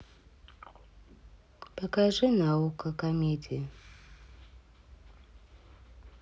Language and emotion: Russian, sad